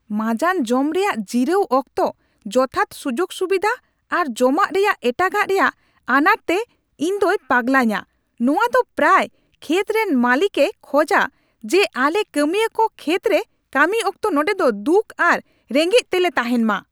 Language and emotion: Santali, angry